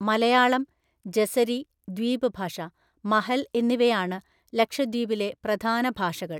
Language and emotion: Malayalam, neutral